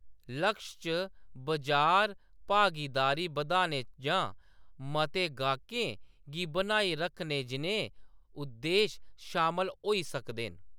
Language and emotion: Dogri, neutral